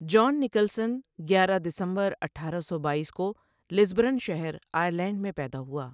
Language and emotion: Urdu, neutral